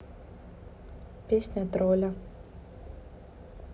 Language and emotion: Russian, neutral